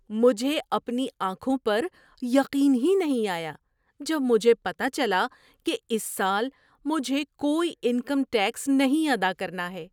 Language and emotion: Urdu, surprised